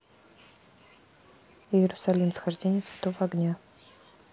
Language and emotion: Russian, neutral